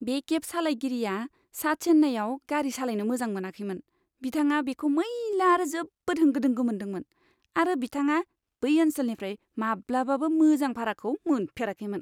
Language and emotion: Bodo, disgusted